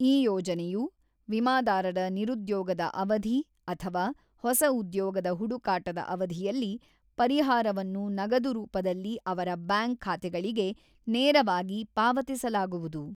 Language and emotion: Kannada, neutral